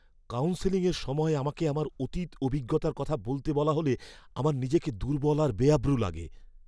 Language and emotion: Bengali, fearful